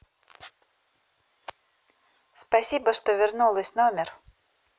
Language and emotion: Russian, neutral